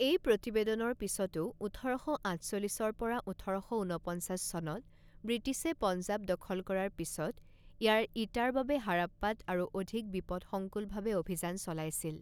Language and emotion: Assamese, neutral